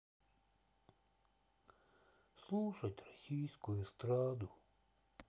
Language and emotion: Russian, sad